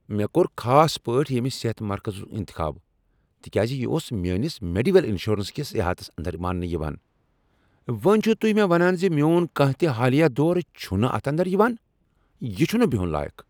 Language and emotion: Kashmiri, angry